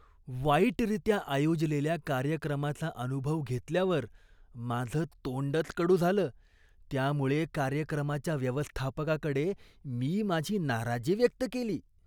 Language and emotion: Marathi, disgusted